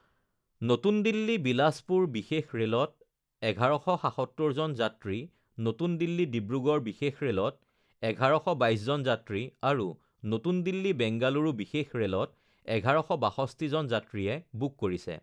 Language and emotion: Assamese, neutral